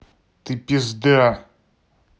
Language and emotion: Russian, angry